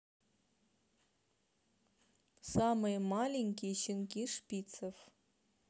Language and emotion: Russian, neutral